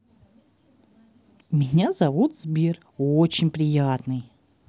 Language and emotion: Russian, positive